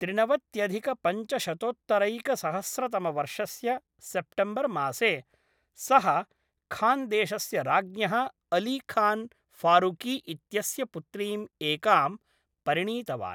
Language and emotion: Sanskrit, neutral